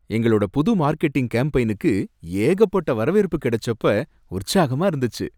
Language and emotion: Tamil, happy